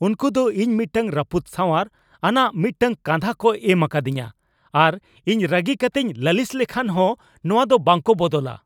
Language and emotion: Santali, angry